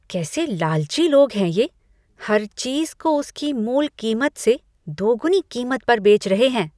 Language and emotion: Hindi, disgusted